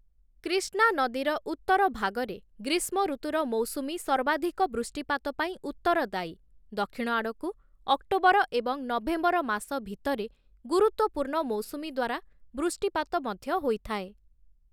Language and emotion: Odia, neutral